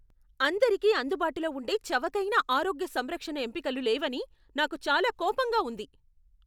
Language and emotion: Telugu, angry